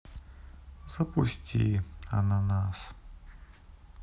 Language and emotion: Russian, sad